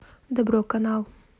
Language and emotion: Russian, neutral